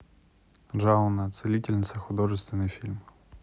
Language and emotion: Russian, neutral